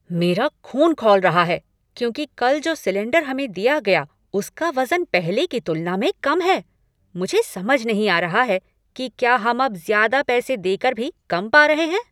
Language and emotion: Hindi, angry